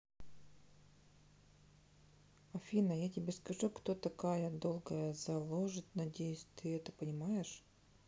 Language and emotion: Russian, neutral